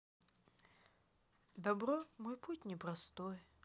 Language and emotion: Russian, sad